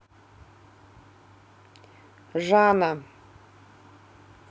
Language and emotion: Russian, neutral